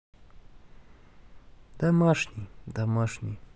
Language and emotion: Russian, sad